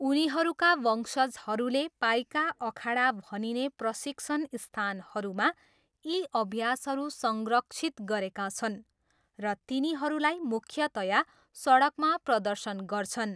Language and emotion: Nepali, neutral